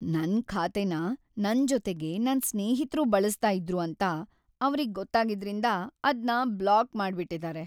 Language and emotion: Kannada, sad